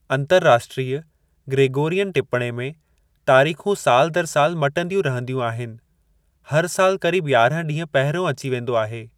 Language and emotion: Sindhi, neutral